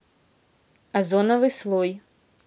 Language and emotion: Russian, neutral